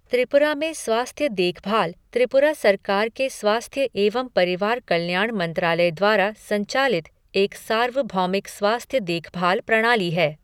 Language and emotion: Hindi, neutral